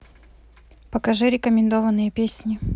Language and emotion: Russian, neutral